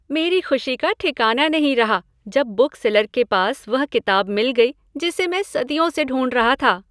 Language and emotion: Hindi, happy